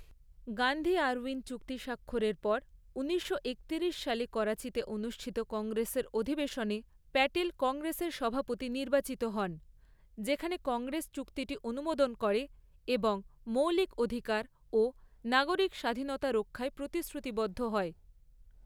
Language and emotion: Bengali, neutral